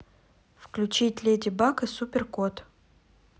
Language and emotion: Russian, neutral